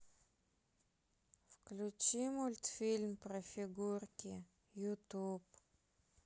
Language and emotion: Russian, sad